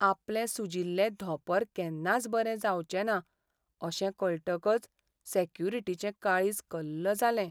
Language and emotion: Goan Konkani, sad